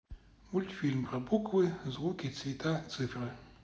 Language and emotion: Russian, neutral